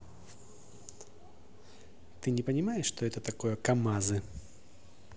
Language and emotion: Russian, angry